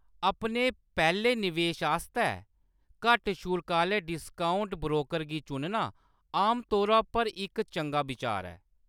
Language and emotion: Dogri, neutral